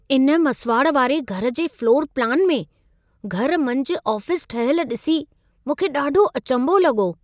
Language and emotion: Sindhi, surprised